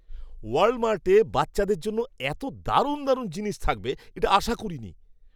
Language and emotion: Bengali, surprised